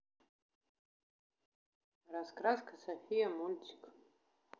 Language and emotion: Russian, neutral